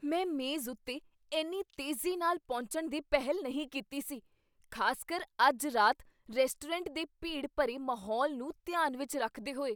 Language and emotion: Punjabi, surprised